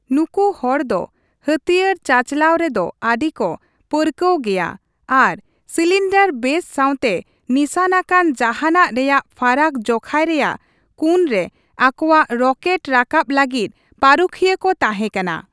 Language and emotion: Santali, neutral